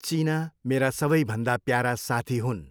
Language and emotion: Nepali, neutral